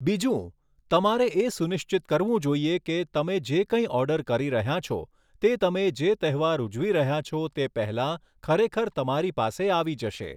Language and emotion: Gujarati, neutral